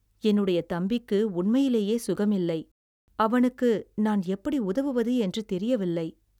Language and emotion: Tamil, sad